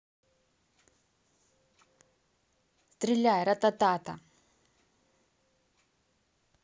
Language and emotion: Russian, neutral